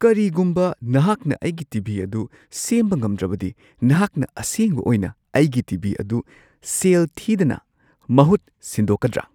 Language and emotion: Manipuri, surprised